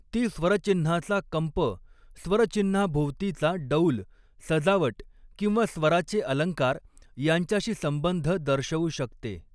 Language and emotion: Marathi, neutral